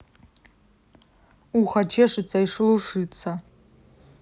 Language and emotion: Russian, neutral